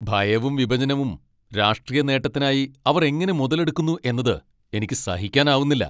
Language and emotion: Malayalam, angry